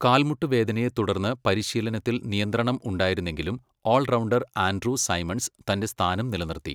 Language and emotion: Malayalam, neutral